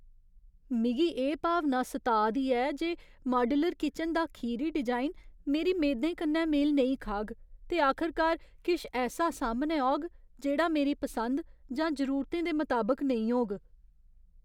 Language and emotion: Dogri, fearful